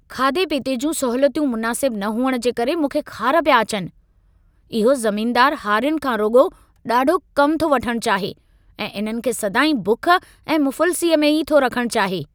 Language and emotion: Sindhi, angry